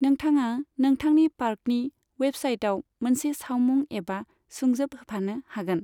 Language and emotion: Bodo, neutral